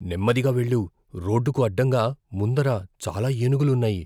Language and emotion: Telugu, fearful